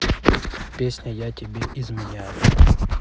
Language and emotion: Russian, neutral